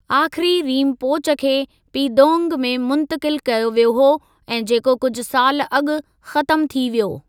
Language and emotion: Sindhi, neutral